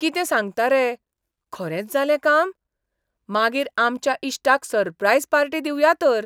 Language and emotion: Goan Konkani, surprised